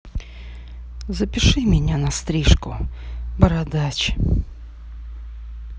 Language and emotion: Russian, sad